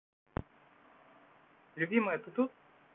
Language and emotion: Russian, neutral